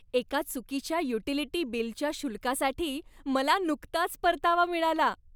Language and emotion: Marathi, happy